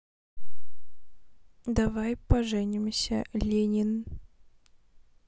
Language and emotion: Russian, neutral